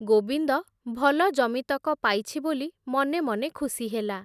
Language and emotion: Odia, neutral